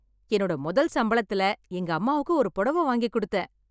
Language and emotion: Tamil, happy